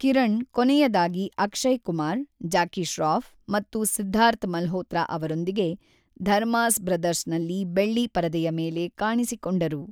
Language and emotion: Kannada, neutral